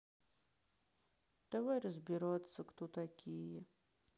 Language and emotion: Russian, sad